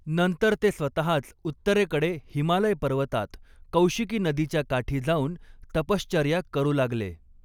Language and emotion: Marathi, neutral